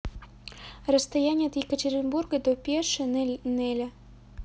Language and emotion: Russian, neutral